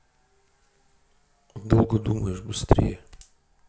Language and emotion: Russian, neutral